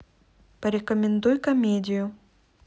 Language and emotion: Russian, neutral